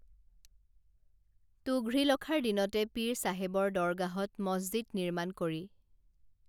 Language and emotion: Assamese, neutral